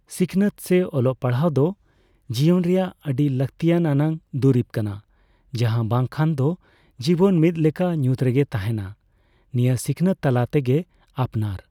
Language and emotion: Santali, neutral